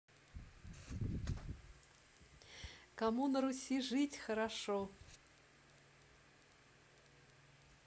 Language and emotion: Russian, positive